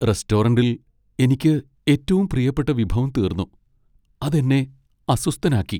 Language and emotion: Malayalam, sad